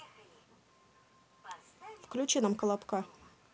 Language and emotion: Russian, neutral